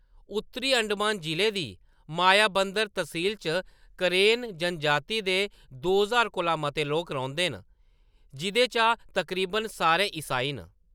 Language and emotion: Dogri, neutral